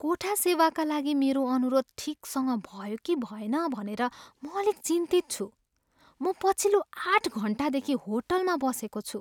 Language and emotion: Nepali, fearful